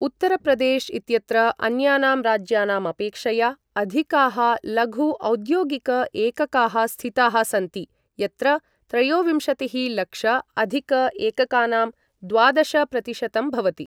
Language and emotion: Sanskrit, neutral